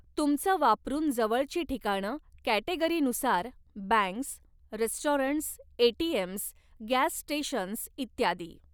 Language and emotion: Marathi, neutral